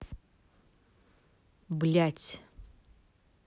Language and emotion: Russian, angry